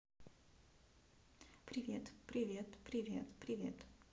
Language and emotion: Russian, neutral